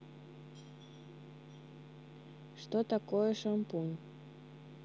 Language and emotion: Russian, neutral